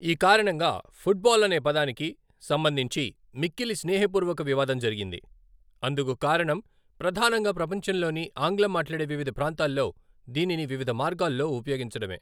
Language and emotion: Telugu, neutral